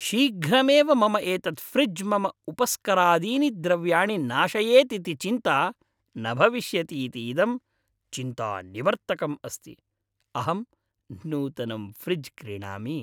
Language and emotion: Sanskrit, happy